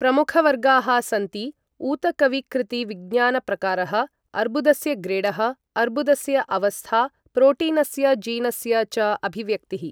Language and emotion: Sanskrit, neutral